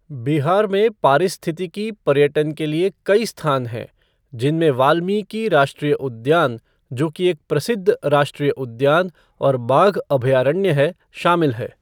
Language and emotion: Hindi, neutral